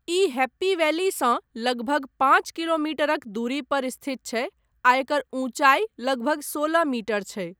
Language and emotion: Maithili, neutral